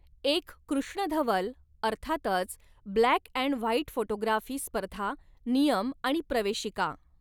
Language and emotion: Marathi, neutral